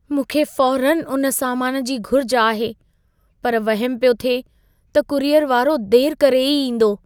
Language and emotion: Sindhi, fearful